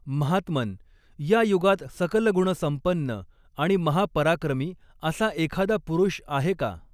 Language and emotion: Marathi, neutral